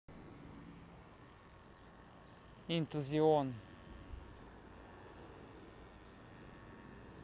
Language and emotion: Russian, neutral